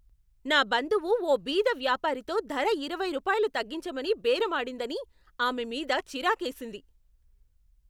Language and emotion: Telugu, angry